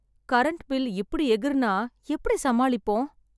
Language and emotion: Tamil, sad